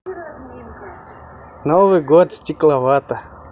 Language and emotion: Russian, positive